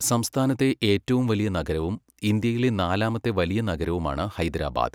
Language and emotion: Malayalam, neutral